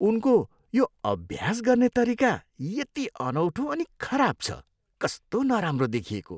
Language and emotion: Nepali, disgusted